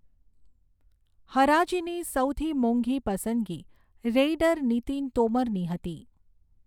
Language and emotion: Gujarati, neutral